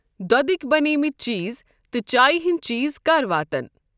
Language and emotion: Kashmiri, neutral